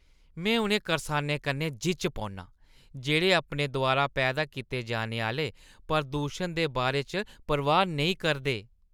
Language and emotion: Dogri, disgusted